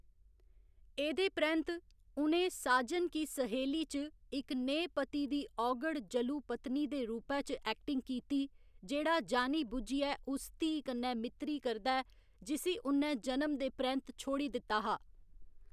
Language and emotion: Dogri, neutral